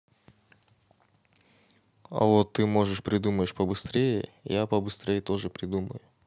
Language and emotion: Russian, neutral